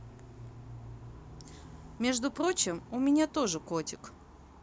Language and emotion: Russian, neutral